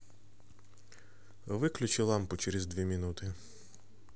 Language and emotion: Russian, neutral